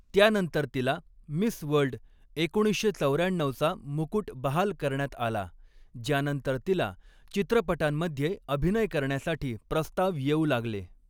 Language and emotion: Marathi, neutral